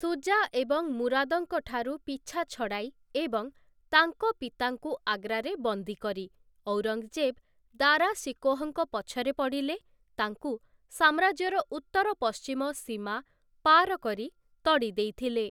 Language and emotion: Odia, neutral